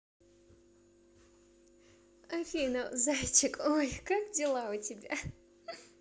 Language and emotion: Russian, positive